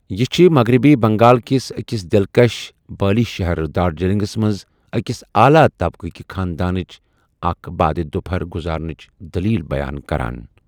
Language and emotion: Kashmiri, neutral